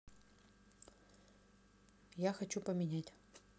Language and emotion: Russian, neutral